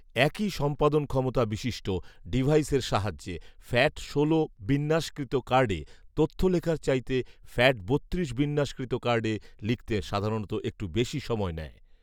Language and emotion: Bengali, neutral